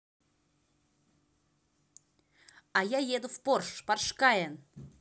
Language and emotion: Russian, positive